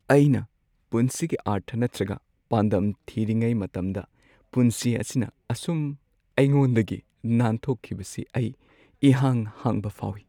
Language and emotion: Manipuri, sad